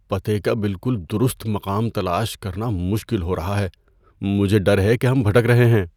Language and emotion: Urdu, fearful